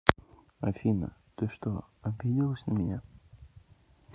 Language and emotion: Russian, neutral